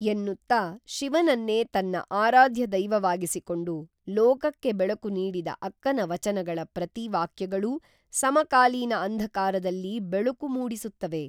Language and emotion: Kannada, neutral